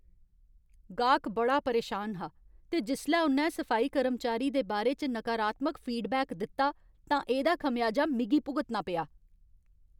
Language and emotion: Dogri, angry